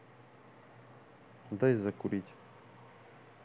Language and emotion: Russian, neutral